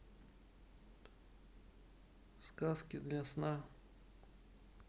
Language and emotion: Russian, neutral